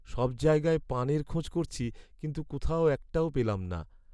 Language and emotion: Bengali, sad